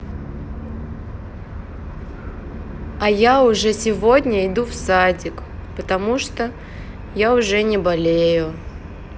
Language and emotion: Russian, neutral